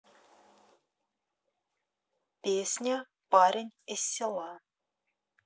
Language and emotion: Russian, neutral